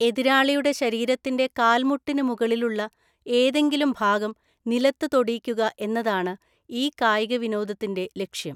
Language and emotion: Malayalam, neutral